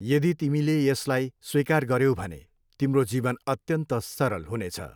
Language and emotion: Nepali, neutral